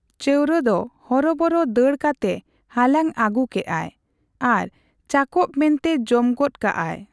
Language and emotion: Santali, neutral